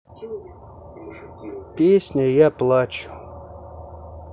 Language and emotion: Russian, neutral